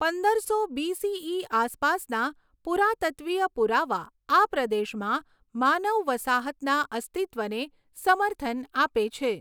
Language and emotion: Gujarati, neutral